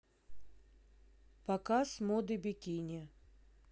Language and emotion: Russian, neutral